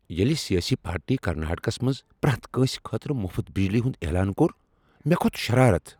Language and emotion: Kashmiri, angry